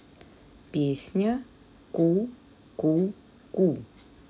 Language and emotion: Russian, neutral